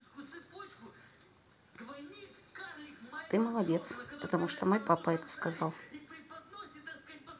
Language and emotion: Russian, neutral